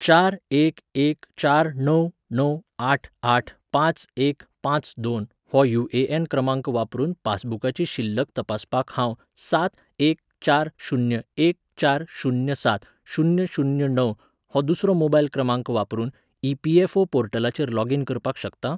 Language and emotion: Goan Konkani, neutral